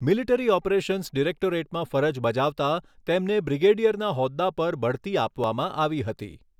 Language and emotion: Gujarati, neutral